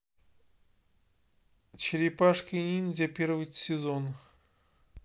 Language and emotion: Russian, neutral